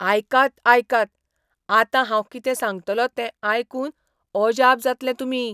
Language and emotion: Goan Konkani, surprised